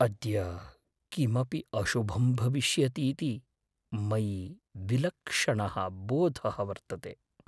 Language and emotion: Sanskrit, fearful